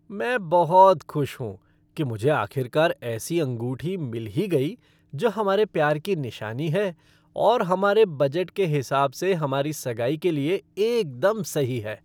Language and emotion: Hindi, happy